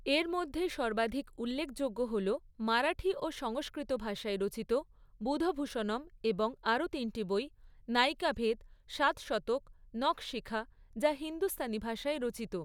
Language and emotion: Bengali, neutral